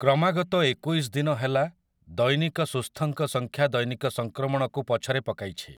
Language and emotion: Odia, neutral